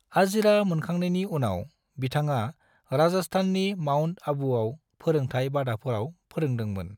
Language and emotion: Bodo, neutral